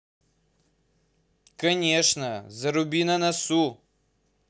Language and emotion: Russian, angry